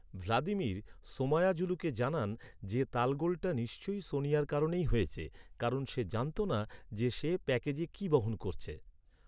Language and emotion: Bengali, neutral